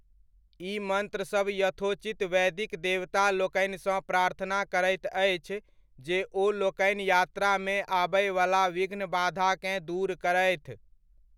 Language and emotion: Maithili, neutral